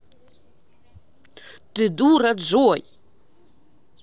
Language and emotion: Russian, angry